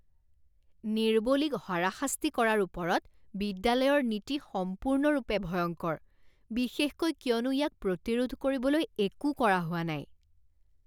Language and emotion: Assamese, disgusted